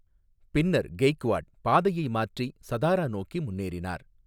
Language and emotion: Tamil, neutral